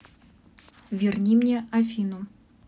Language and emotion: Russian, neutral